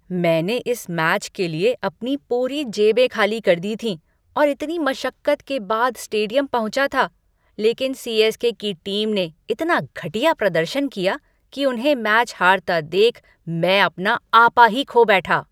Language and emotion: Hindi, angry